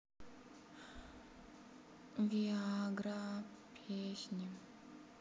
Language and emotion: Russian, sad